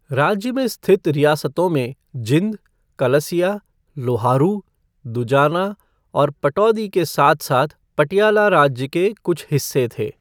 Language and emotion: Hindi, neutral